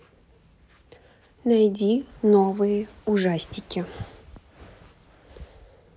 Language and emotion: Russian, neutral